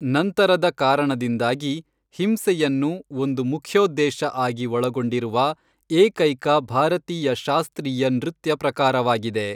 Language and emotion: Kannada, neutral